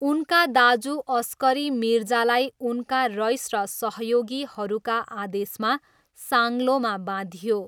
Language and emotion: Nepali, neutral